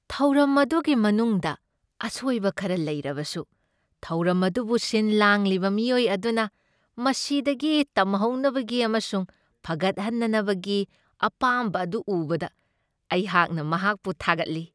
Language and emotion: Manipuri, happy